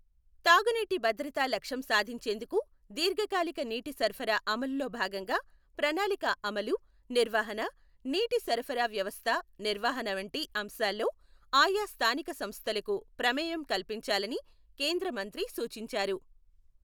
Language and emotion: Telugu, neutral